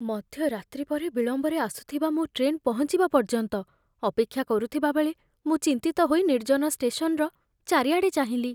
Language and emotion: Odia, fearful